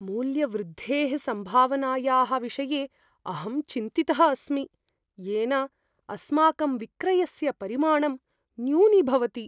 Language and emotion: Sanskrit, fearful